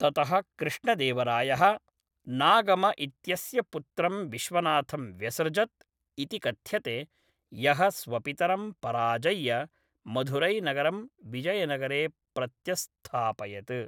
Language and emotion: Sanskrit, neutral